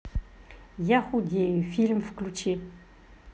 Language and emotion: Russian, neutral